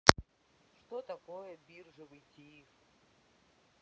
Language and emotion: Russian, neutral